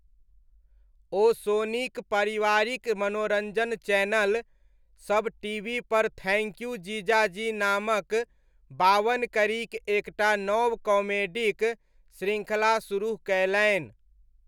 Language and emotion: Maithili, neutral